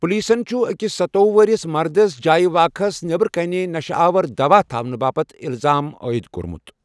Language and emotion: Kashmiri, neutral